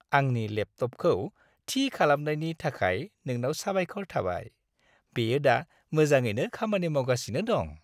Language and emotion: Bodo, happy